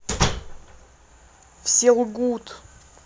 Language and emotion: Russian, sad